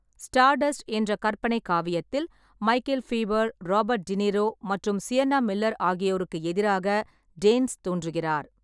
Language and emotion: Tamil, neutral